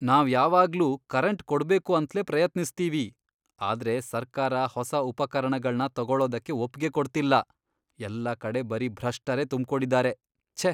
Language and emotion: Kannada, disgusted